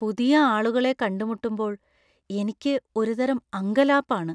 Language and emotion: Malayalam, fearful